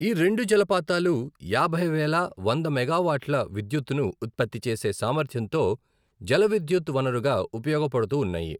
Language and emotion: Telugu, neutral